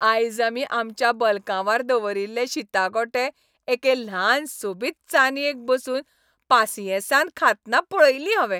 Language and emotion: Goan Konkani, happy